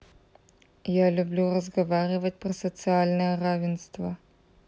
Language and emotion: Russian, neutral